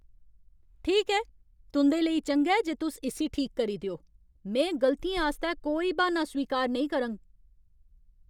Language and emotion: Dogri, angry